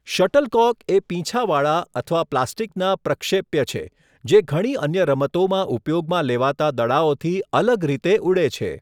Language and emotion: Gujarati, neutral